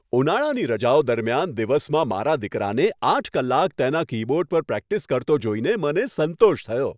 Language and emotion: Gujarati, happy